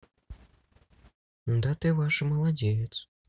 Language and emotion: Russian, neutral